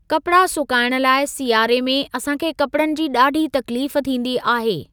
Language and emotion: Sindhi, neutral